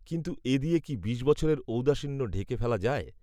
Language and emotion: Bengali, neutral